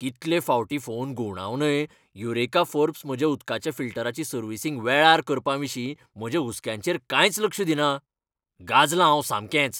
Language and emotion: Goan Konkani, angry